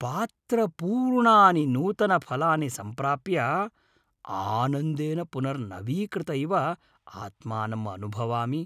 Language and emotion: Sanskrit, happy